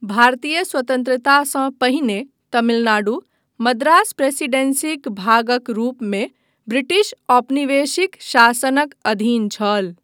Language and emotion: Maithili, neutral